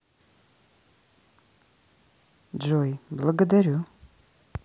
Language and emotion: Russian, neutral